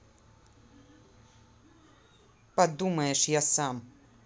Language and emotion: Russian, angry